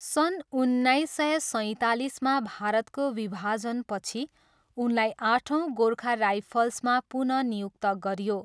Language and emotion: Nepali, neutral